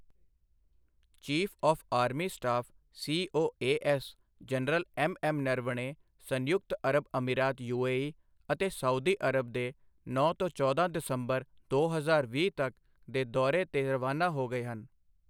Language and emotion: Punjabi, neutral